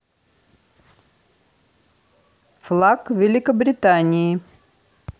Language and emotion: Russian, neutral